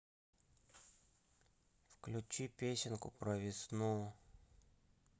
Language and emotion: Russian, sad